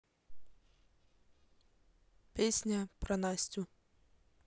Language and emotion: Russian, neutral